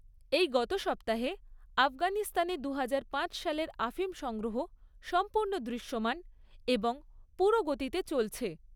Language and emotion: Bengali, neutral